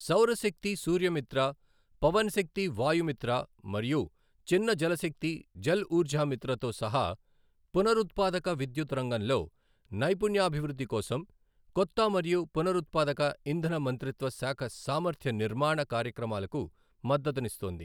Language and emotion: Telugu, neutral